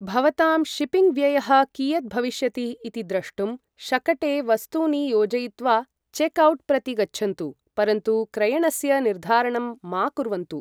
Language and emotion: Sanskrit, neutral